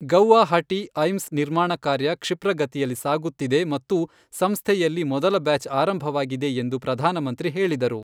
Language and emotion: Kannada, neutral